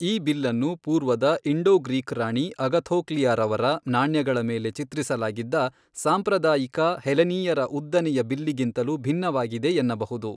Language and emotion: Kannada, neutral